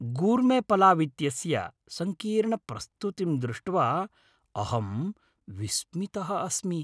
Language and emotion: Sanskrit, happy